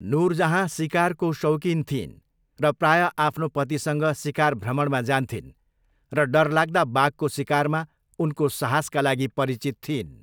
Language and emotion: Nepali, neutral